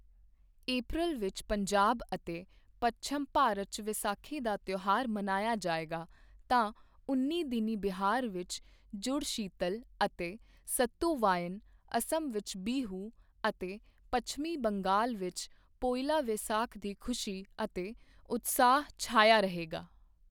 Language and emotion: Punjabi, neutral